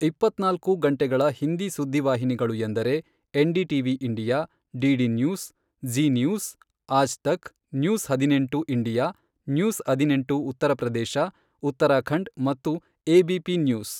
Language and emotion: Kannada, neutral